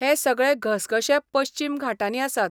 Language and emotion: Goan Konkani, neutral